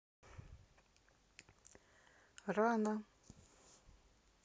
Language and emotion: Russian, neutral